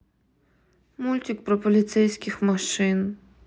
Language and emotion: Russian, sad